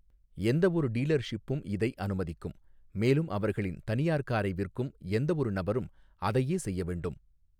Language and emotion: Tamil, neutral